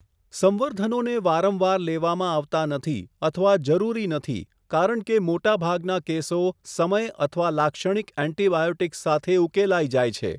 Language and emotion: Gujarati, neutral